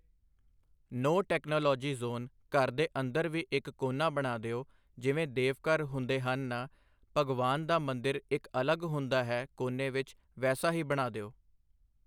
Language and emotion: Punjabi, neutral